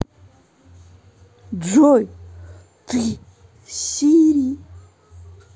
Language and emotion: Russian, positive